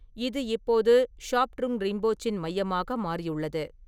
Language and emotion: Tamil, neutral